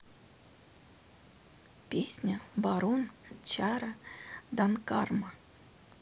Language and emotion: Russian, neutral